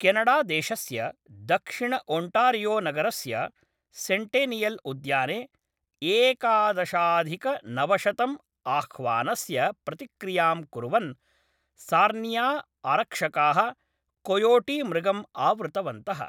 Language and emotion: Sanskrit, neutral